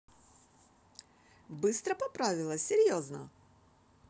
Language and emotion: Russian, positive